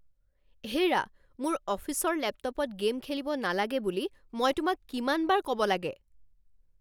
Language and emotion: Assamese, angry